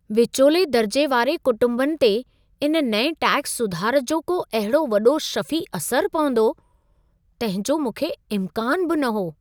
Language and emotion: Sindhi, surprised